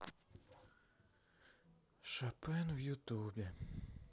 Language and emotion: Russian, sad